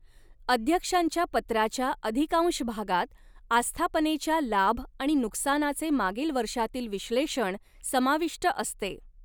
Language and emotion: Marathi, neutral